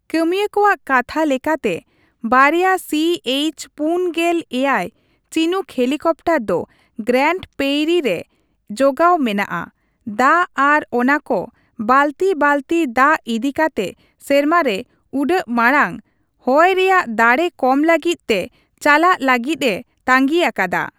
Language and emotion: Santali, neutral